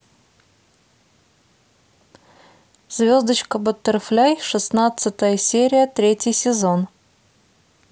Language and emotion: Russian, neutral